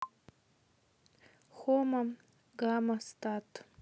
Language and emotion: Russian, neutral